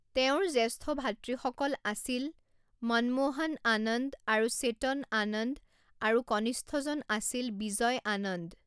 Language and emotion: Assamese, neutral